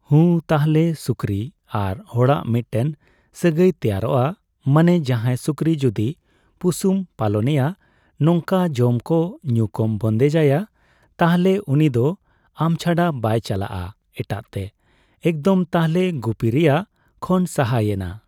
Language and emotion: Santali, neutral